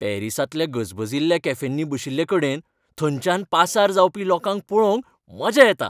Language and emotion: Goan Konkani, happy